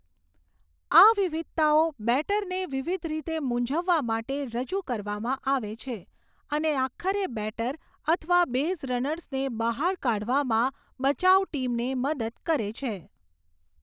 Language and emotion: Gujarati, neutral